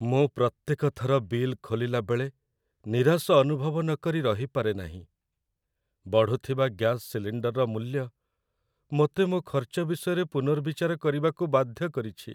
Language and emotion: Odia, sad